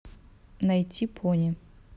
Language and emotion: Russian, neutral